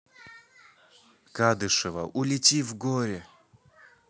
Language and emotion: Russian, neutral